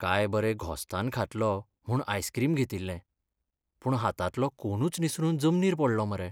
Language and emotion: Goan Konkani, sad